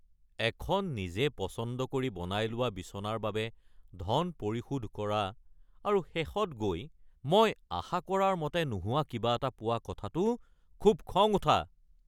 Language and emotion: Assamese, angry